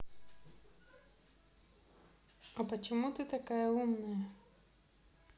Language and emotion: Russian, neutral